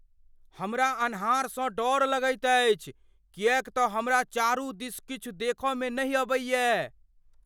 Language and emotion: Maithili, fearful